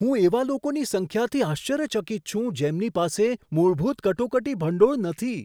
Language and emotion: Gujarati, surprised